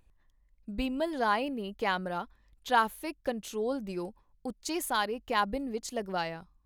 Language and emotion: Punjabi, neutral